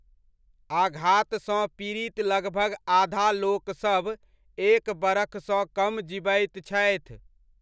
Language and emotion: Maithili, neutral